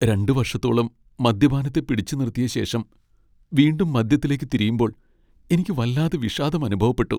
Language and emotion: Malayalam, sad